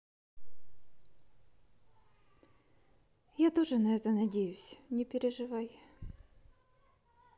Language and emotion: Russian, sad